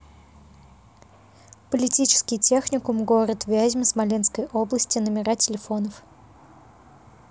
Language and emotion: Russian, neutral